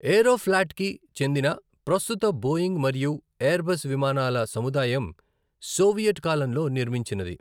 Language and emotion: Telugu, neutral